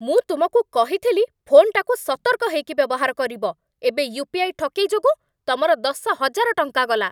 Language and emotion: Odia, angry